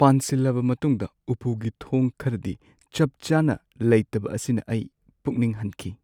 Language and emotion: Manipuri, sad